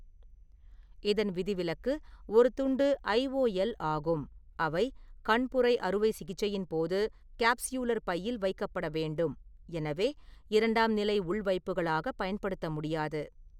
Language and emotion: Tamil, neutral